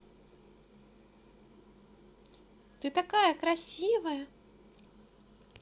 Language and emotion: Russian, positive